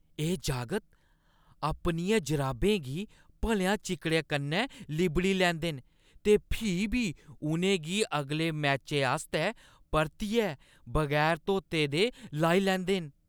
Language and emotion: Dogri, disgusted